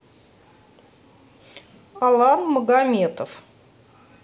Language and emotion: Russian, neutral